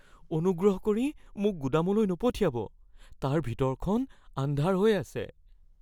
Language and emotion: Assamese, fearful